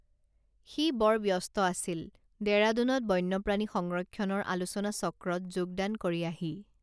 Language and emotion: Assamese, neutral